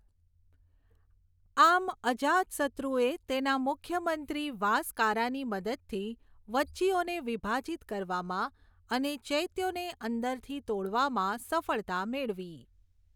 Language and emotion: Gujarati, neutral